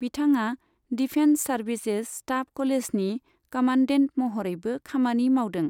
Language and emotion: Bodo, neutral